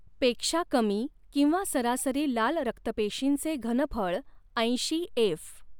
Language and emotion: Marathi, neutral